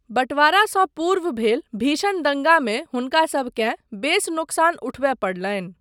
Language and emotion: Maithili, neutral